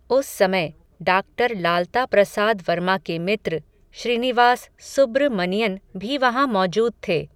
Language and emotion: Hindi, neutral